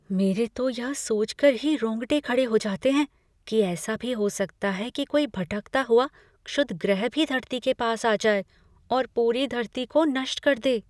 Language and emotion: Hindi, fearful